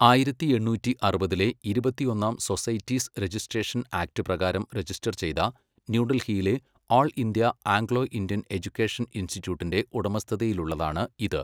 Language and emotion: Malayalam, neutral